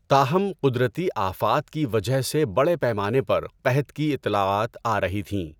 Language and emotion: Urdu, neutral